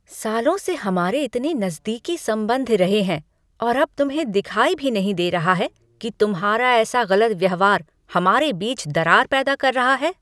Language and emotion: Hindi, angry